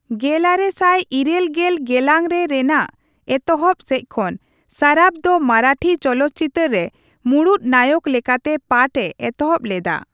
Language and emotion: Santali, neutral